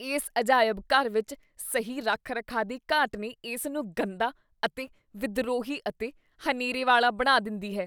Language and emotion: Punjabi, disgusted